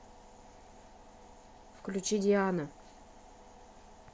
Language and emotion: Russian, neutral